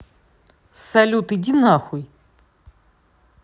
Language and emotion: Russian, angry